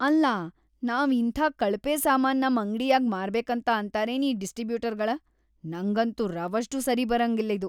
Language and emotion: Kannada, disgusted